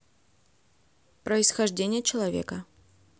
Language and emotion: Russian, neutral